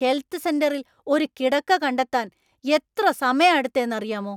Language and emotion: Malayalam, angry